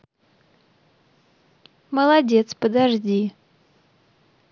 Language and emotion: Russian, positive